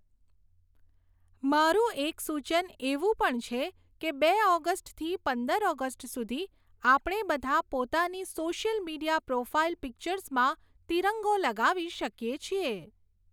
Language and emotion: Gujarati, neutral